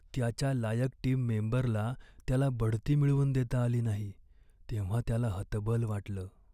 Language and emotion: Marathi, sad